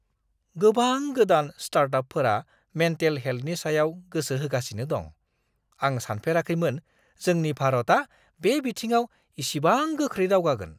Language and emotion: Bodo, surprised